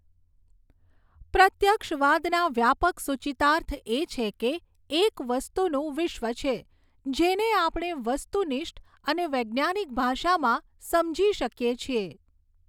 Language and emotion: Gujarati, neutral